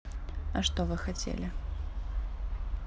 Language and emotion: Russian, neutral